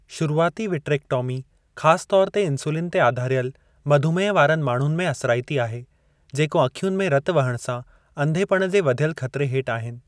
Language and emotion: Sindhi, neutral